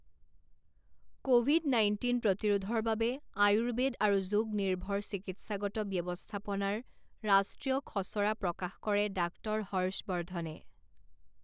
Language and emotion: Assamese, neutral